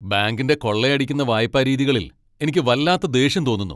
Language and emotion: Malayalam, angry